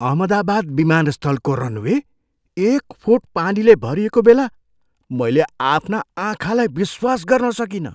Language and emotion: Nepali, surprised